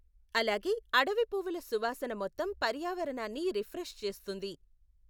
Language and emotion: Telugu, neutral